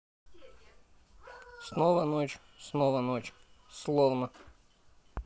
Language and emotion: Russian, sad